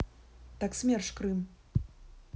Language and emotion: Russian, neutral